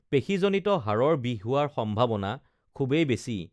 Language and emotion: Assamese, neutral